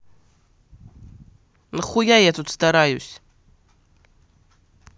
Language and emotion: Russian, angry